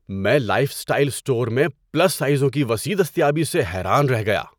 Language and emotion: Urdu, surprised